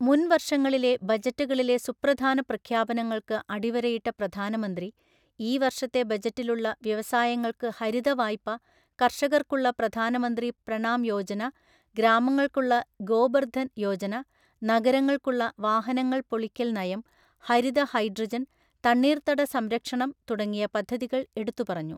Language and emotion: Malayalam, neutral